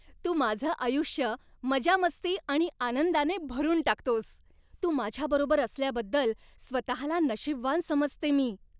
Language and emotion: Marathi, happy